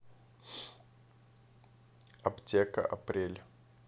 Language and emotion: Russian, neutral